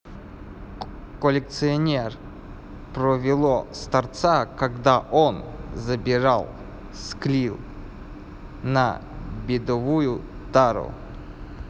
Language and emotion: Russian, neutral